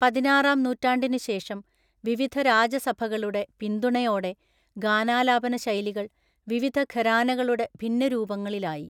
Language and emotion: Malayalam, neutral